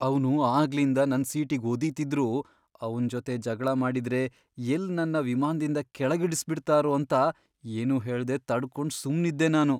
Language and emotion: Kannada, fearful